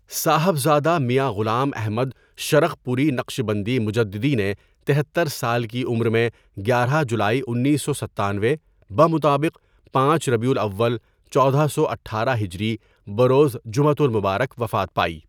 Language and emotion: Urdu, neutral